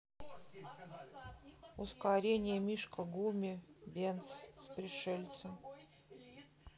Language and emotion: Russian, neutral